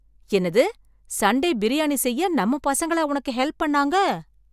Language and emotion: Tamil, surprised